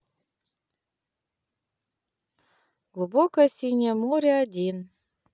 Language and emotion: Russian, neutral